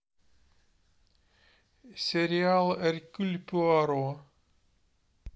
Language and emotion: Russian, neutral